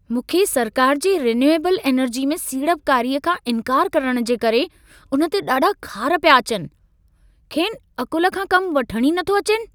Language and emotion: Sindhi, angry